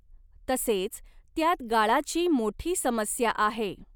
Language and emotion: Marathi, neutral